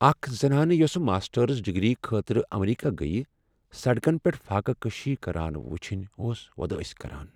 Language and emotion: Kashmiri, sad